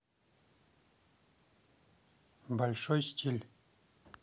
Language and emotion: Russian, neutral